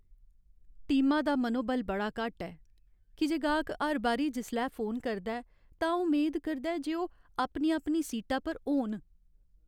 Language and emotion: Dogri, sad